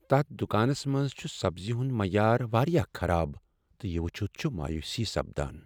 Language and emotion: Kashmiri, sad